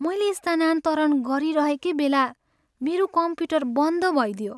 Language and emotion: Nepali, sad